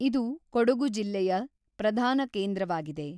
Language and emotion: Kannada, neutral